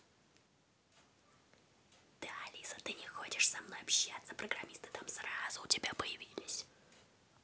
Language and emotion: Russian, neutral